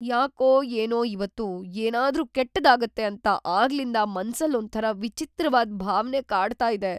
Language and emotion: Kannada, fearful